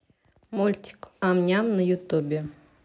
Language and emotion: Russian, neutral